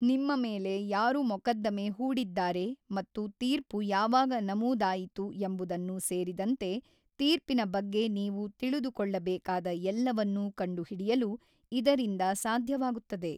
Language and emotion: Kannada, neutral